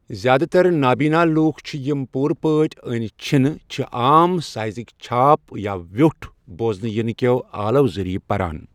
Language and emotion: Kashmiri, neutral